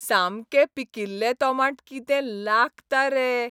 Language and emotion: Goan Konkani, happy